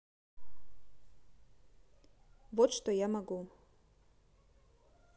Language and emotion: Russian, neutral